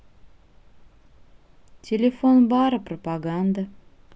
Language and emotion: Russian, neutral